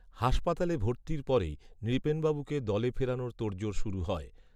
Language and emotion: Bengali, neutral